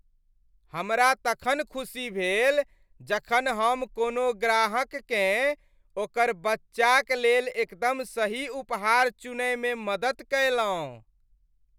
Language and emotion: Maithili, happy